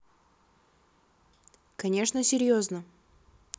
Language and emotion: Russian, neutral